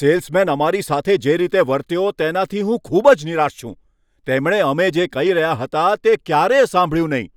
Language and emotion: Gujarati, angry